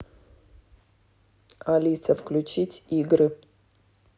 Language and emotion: Russian, neutral